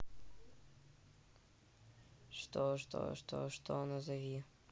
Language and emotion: Russian, neutral